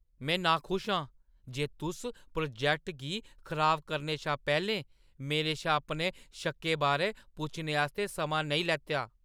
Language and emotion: Dogri, angry